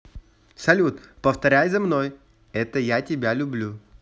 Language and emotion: Russian, positive